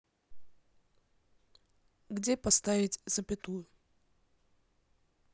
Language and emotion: Russian, neutral